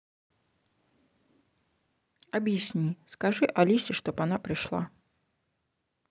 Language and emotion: Russian, neutral